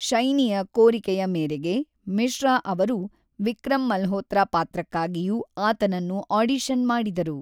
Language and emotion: Kannada, neutral